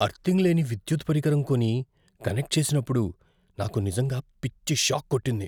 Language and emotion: Telugu, fearful